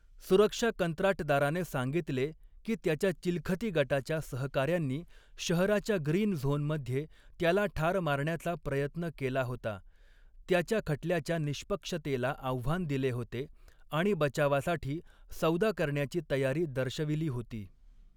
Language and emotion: Marathi, neutral